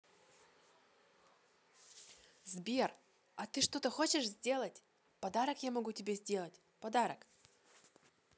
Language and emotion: Russian, positive